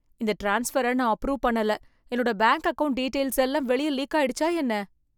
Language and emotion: Tamil, fearful